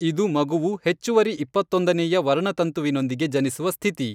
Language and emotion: Kannada, neutral